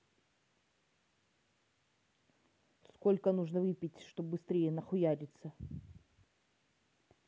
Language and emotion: Russian, angry